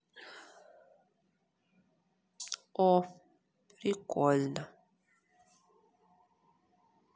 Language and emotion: Russian, neutral